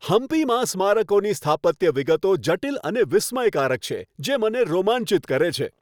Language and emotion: Gujarati, happy